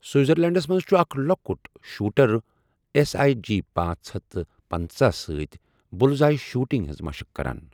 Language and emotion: Kashmiri, neutral